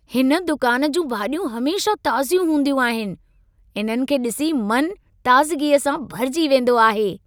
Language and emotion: Sindhi, happy